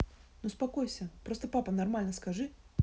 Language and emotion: Russian, neutral